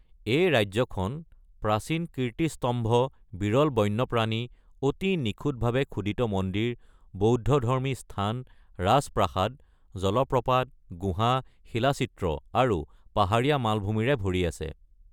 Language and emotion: Assamese, neutral